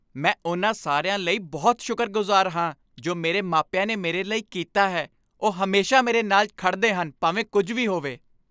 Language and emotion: Punjabi, happy